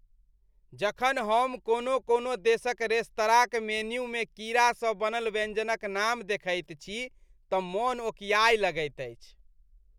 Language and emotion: Maithili, disgusted